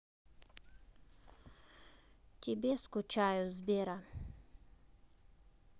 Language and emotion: Russian, neutral